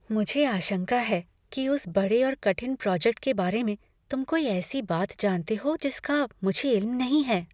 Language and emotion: Hindi, fearful